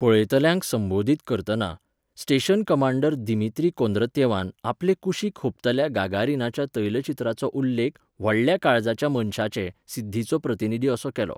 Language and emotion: Goan Konkani, neutral